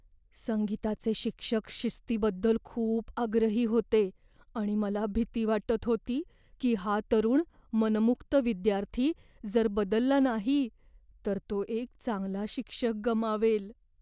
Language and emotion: Marathi, fearful